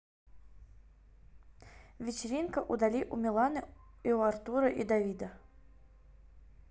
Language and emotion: Russian, neutral